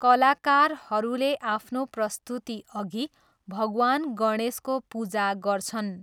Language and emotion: Nepali, neutral